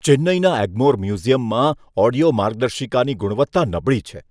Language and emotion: Gujarati, disgusted